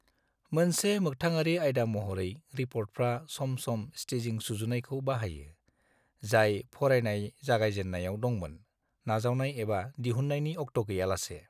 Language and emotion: Bodo, neutral